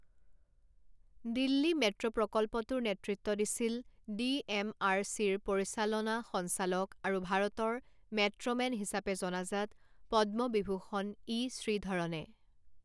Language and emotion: Assamese, neutral